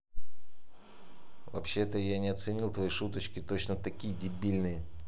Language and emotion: Russian, angry